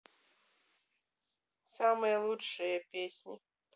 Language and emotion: Russian, neutral